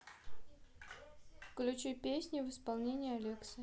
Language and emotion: Russian, neutral